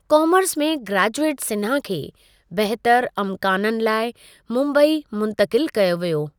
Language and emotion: Sindhi, neutral